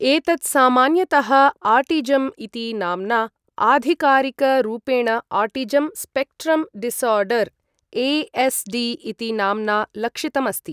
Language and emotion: Sanskrit, neutral